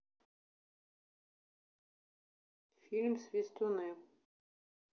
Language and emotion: Russian, neutral